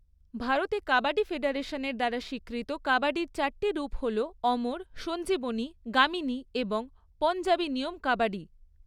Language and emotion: Bengali, neutral